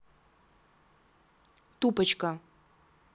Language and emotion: Russian, neutral